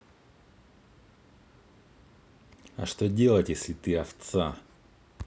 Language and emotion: Russian, angry